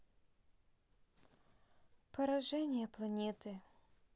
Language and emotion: Russian, sad